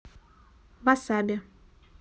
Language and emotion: Russian, neutral